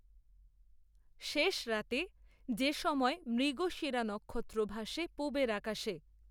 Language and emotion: Bengali, neutral